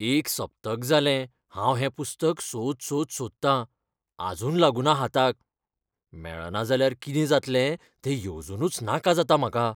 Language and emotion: Goan Konkani, fearful